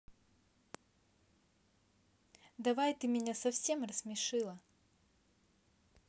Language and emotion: Russian, neutral